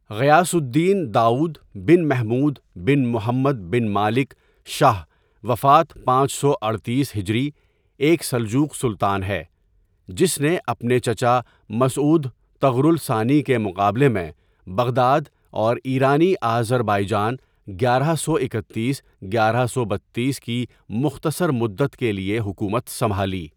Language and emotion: Urdu, neutral